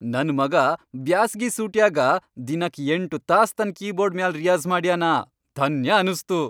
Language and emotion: Kannada, happy